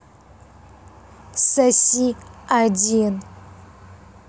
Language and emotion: Russian, angry